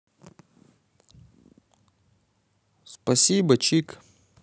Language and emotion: Russian, positive